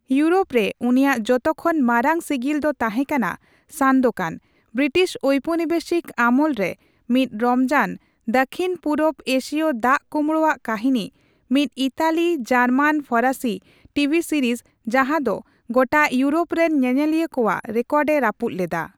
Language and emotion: Santali, neutral